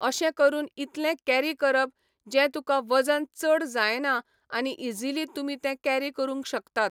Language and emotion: Goan Konkani, neutral